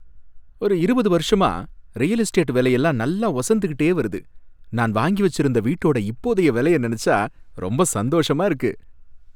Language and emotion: Tamil, happy